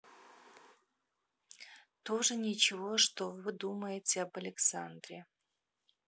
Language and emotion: Russian, neutral